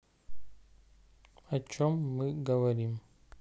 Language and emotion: Russian, neutral